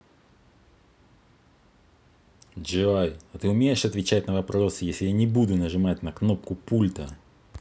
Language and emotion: Russian, angry